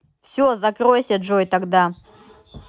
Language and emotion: Russian, angry